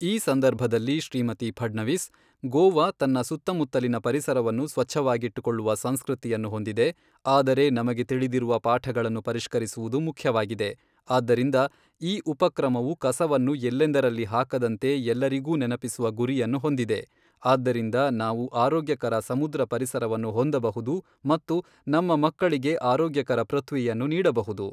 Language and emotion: Kannada, neutral